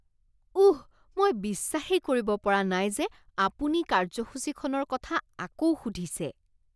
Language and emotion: Assamese, disgusted